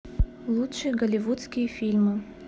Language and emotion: Russian, neutral